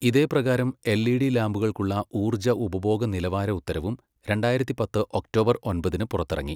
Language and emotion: Malayalam, neutral